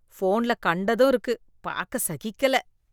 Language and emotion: Tamil, disgusted